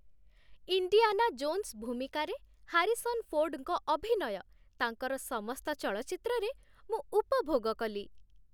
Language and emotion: Odia, happy